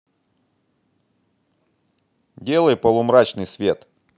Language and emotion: Russian, angry